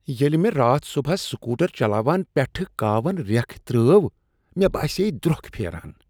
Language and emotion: Kashmiri, disgusted